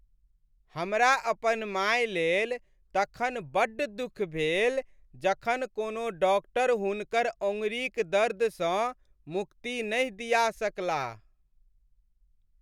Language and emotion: Maithili, sad